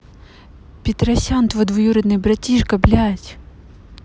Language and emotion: Russian, neutral